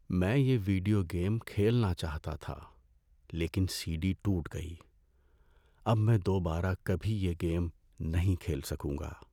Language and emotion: Urdu, sad